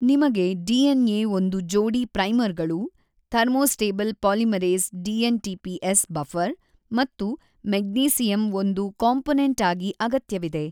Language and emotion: Kannada, neutral